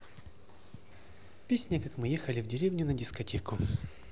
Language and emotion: Russian, neutral